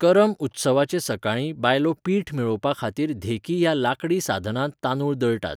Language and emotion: Goan Konkani, neutral